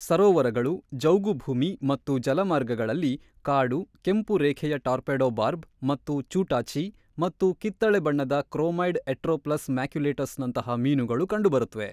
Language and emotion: Kannada, neutral